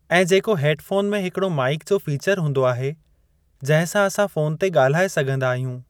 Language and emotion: Sindhi, neutral